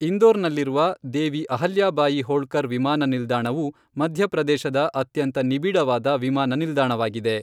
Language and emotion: Kannada, neutral